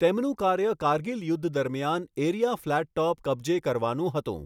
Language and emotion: Gujarati, neutral